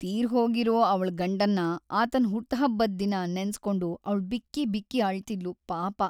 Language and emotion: Kannada, sad